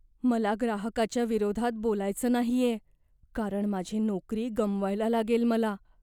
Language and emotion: Marathi, fearful